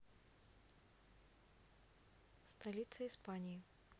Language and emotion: Russian, neutral